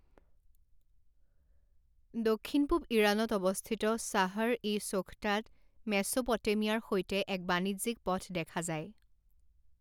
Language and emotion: Assamese, neutral